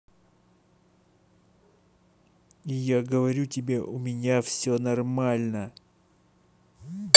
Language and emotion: Russian, angry